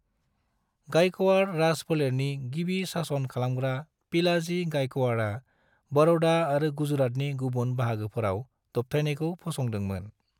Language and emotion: Bodo, neutral